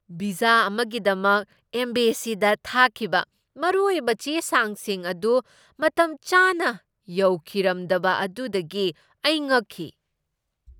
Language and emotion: Manipuri, surprised